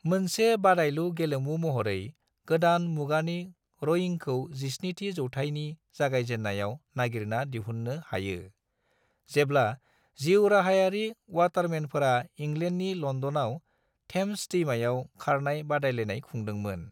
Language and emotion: Bodo, neutral